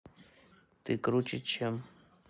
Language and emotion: Russian, neutral